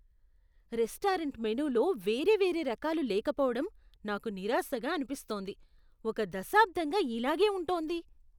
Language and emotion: Telugu, disgusted